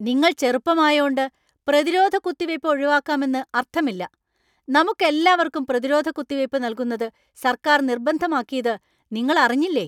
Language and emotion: Malayalam, angry